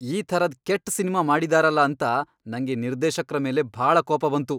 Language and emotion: Kannada, angry